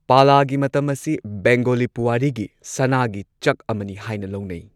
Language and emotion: Manipuri, neutral